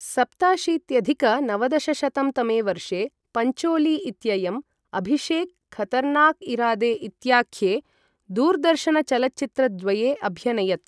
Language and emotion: Sanskrit, neutral